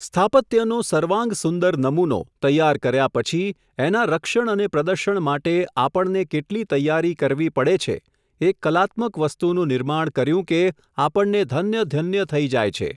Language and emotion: Gujarati, neutral